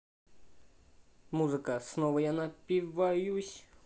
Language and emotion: Russian, positive